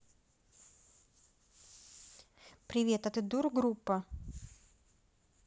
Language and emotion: Russian, neutral